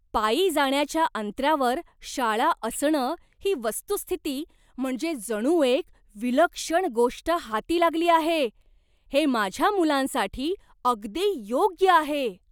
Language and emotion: Marathi, surprised